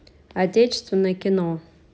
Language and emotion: Russian, neutral